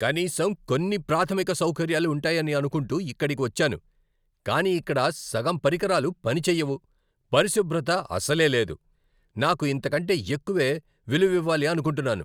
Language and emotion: Telugu, angry